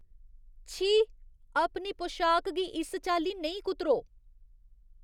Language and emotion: Dogri, disgusted